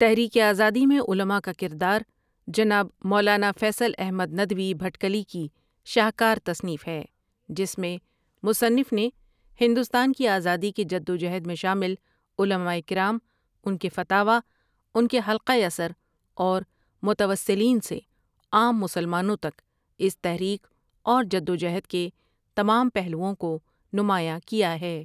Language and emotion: Urdu, neutral